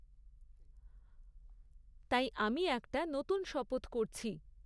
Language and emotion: Bengali, neutral